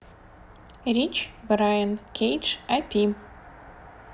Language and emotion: Russian, neutral